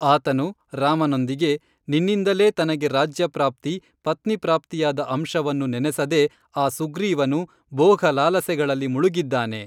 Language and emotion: Kannada, neutral